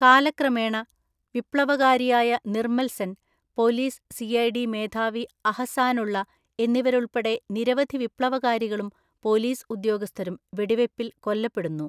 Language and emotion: Malayalam, neutral